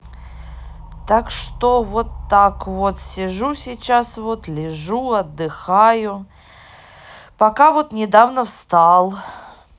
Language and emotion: Russian, neutral